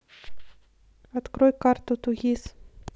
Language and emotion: Russian, neutral